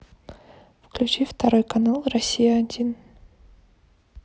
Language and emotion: Russian, neutral